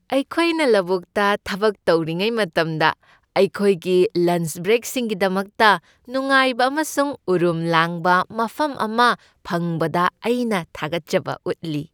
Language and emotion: Manipuri, happy